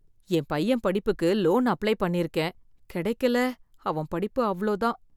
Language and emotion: Tamil, fearful